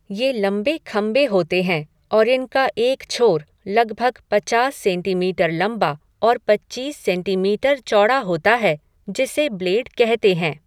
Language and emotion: Hindi, neutral